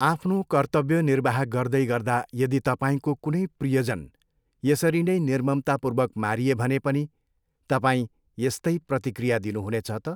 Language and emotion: Nepali, neutral